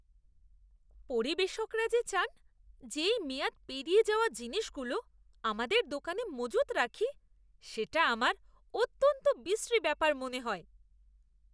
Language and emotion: Bengali, disgusted